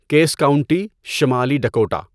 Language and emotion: Urdu, neutral